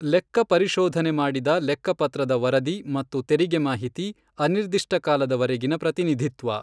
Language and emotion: Kannada, neutral